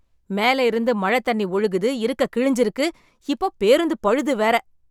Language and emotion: Tamil, angry